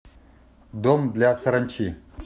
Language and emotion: Russian, neutral